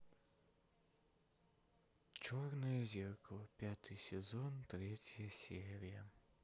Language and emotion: Russian, sad